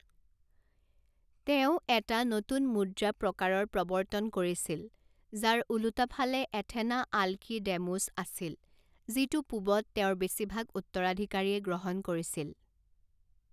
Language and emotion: Assamese, neutral